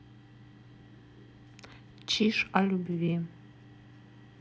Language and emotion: Russian, neutral